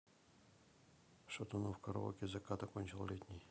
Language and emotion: Russian, neutral